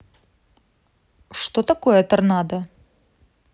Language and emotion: Russian, neutral